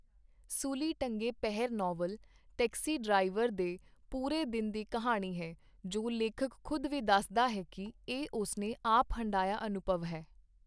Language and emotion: Punjabi, neutral